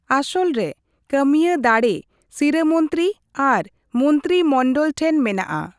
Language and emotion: Santali, neutral